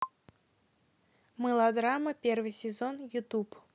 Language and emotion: Russian, neutral